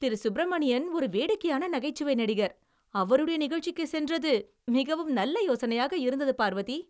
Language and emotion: Tamil, happy